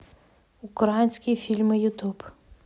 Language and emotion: Russian, neutral